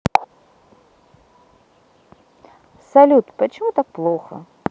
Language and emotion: Russian, sad